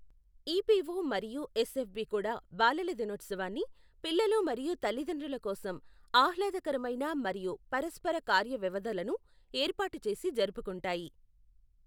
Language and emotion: Telugu, neutral